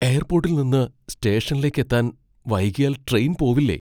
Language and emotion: Malayalam, fearful